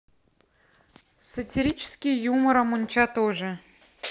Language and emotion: Russian, neutral